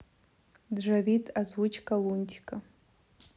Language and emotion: Russian, neutral